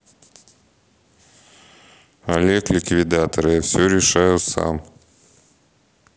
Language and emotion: Russian, neutral